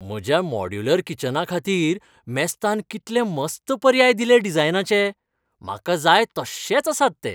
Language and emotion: Goan Konkani, happy